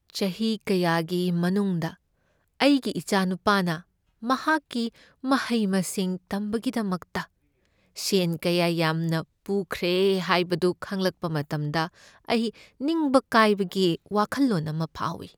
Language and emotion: Manipuri, sad